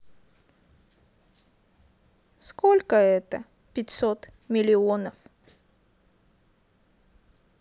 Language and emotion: Russian, sad